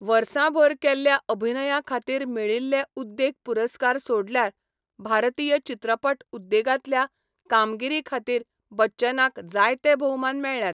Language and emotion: Goan Konkani, neutral